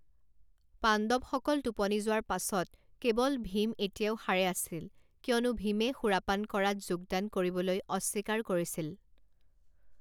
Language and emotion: Assamese, neutral